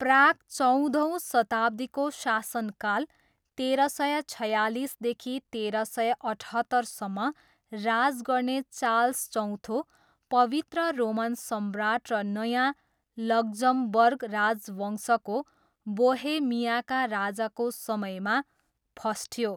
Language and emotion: Nepali, neutral